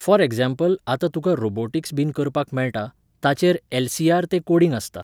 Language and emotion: Goan Konkani, neutral